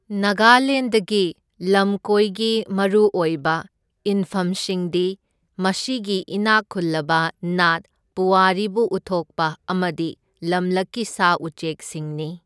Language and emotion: Manipuri, neutral